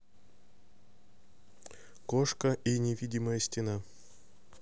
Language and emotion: Russian, neutral